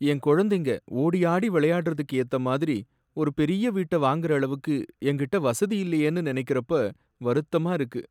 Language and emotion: Tamil, sad